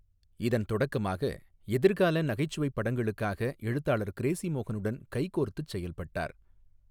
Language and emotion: Tamil, neutral